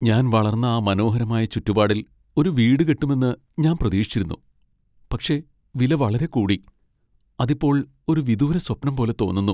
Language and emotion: Malayalam, sad